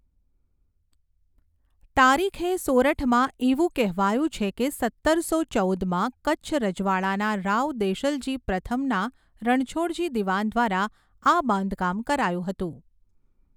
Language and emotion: Gujarati, neutral